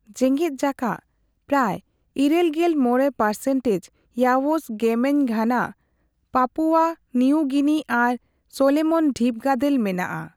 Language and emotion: Santali, neutral